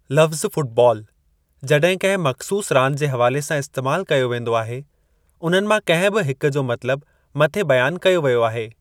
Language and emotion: Sindhi, neutral